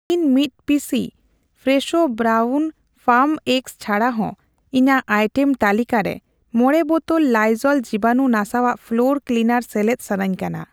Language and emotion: Santali, neutral